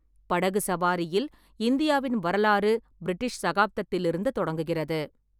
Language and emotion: Tamil, neutral